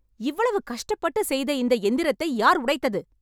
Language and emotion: Tamil, angry